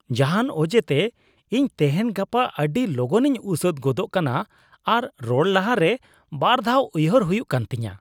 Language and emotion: Santali, disgusted